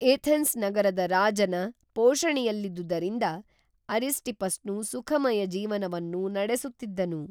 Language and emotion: Kannada, neutral